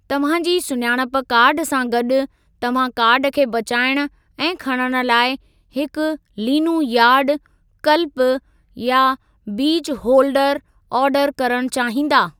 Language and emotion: Sindhi, neutral